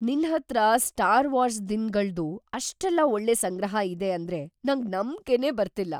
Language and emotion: Kannada, surprised